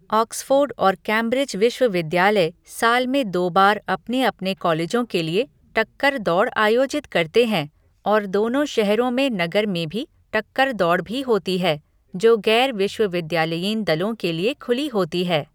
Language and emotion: Hindi, neutral